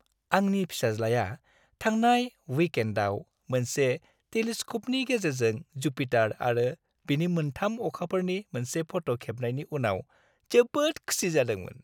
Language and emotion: Bodo, happy